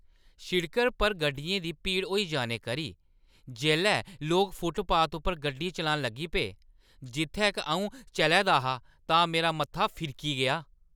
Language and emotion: Dogri, angry